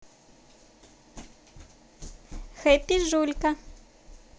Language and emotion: Russian, positive